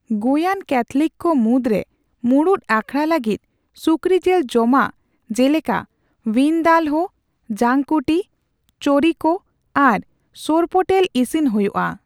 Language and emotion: Santali, neutral